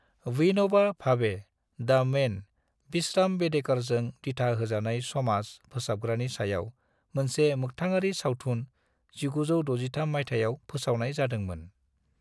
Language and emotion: Bodo, neutral